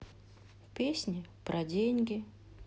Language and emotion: Russian, sad